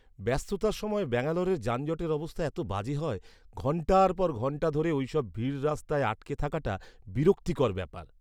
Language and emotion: Bengali, disgusted